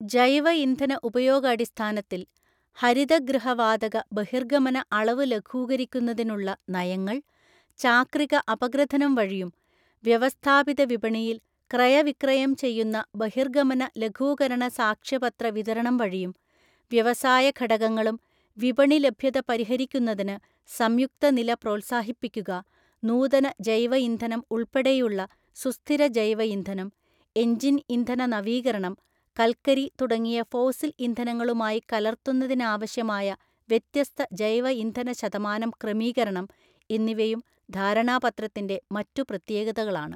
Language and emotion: Malayalam, neutral